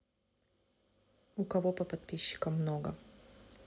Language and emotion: Russian, neutral